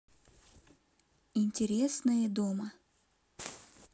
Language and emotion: Russian, neutral